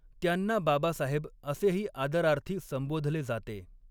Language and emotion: Marathi, neutral